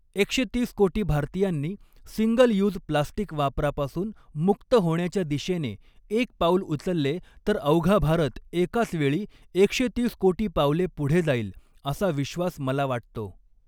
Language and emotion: Marathi, neutral